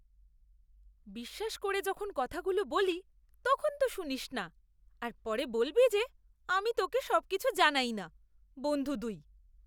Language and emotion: Bengali, disgusted